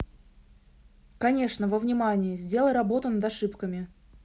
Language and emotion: Russian, neutral